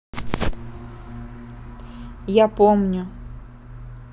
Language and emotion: Russian, neutral